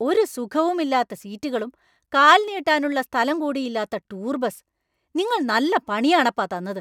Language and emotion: Malayalam, angry